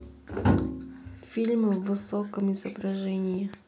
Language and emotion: Russian, neutral